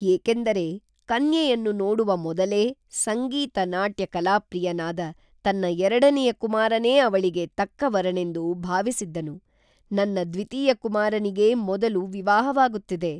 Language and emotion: Kannada, neutral